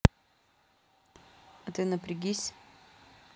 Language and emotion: Russian, neutral